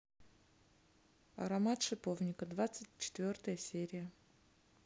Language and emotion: Russian, neutral